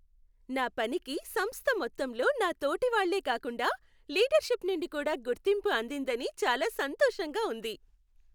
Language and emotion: Telugu, happy